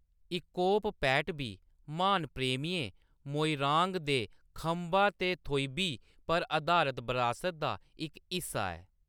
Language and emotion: Dogri, neutral